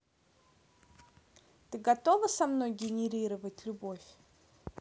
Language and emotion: Russian, neutral